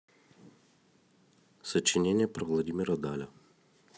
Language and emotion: Russian, neutral